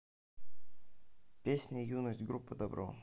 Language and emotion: Russian, neutral